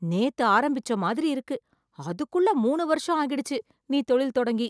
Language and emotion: Tamil, surprised